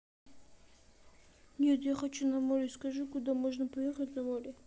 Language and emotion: Russian, sad